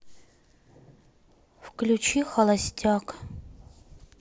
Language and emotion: Russian, sad